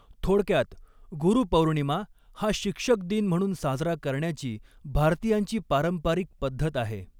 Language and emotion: Marathi, neutral